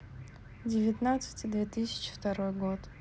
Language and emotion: Russian, neutral